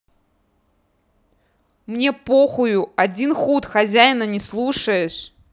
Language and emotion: Russian, angry